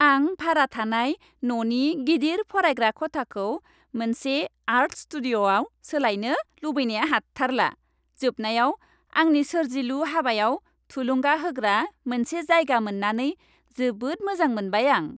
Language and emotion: Bodo, happy